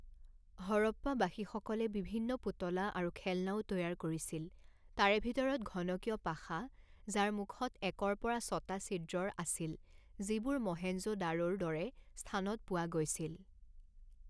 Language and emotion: Assamese, neutral